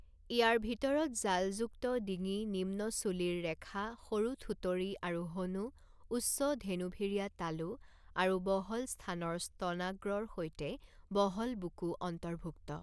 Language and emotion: Assamese, neutral